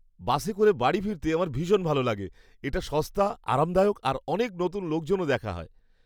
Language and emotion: Bengali, happy